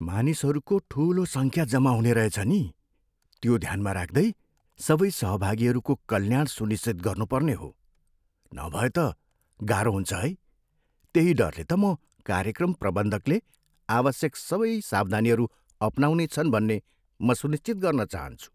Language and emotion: Nepali, fearful